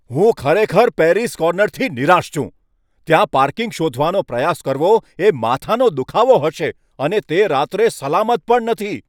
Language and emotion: Gujarati, angry